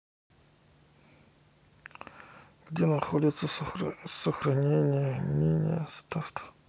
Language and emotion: Russian, neutral